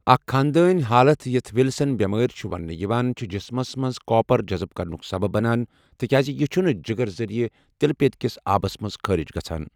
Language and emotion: Kashmiri, neutral